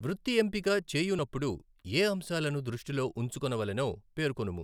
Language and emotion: Telugu, neutral